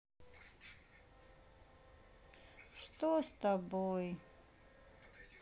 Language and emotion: Russian, sad